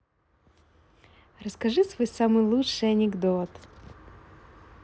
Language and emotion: Russian, positive